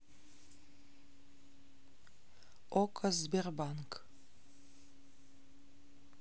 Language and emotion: Russian, neutral